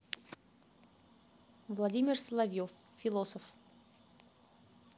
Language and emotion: Russian, neutral